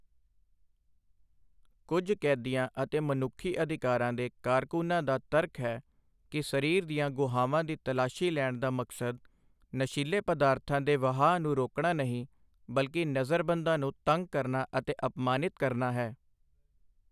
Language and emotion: Punjabi, neutral